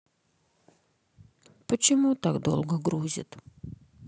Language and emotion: Russian, sad